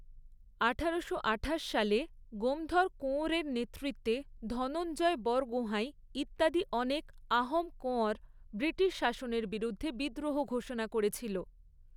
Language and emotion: Bengali, neutral